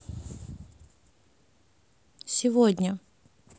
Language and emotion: Russian, neutral